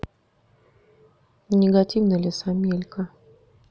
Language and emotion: Russian, neutral